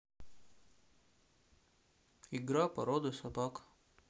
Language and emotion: Russian, neutral